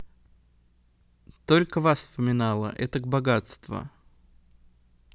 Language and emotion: Russian, neutral